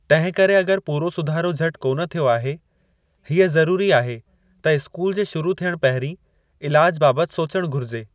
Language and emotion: Sindhi, neutral